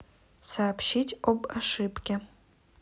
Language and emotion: Russian, neutral